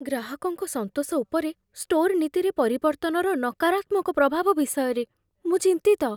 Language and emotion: Odia, fearful